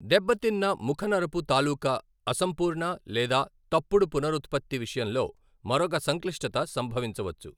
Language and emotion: Telugu, neutral